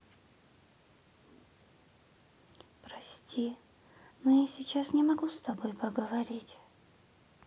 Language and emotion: Russian, sad